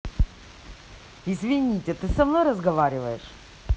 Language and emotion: Russian, neutral